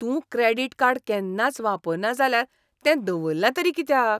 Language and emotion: Goan Konkani, disgusted